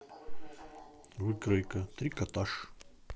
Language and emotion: Russian, neutral